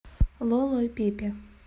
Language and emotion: Russian, neutral